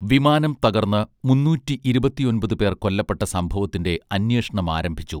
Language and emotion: Malayalam, neutral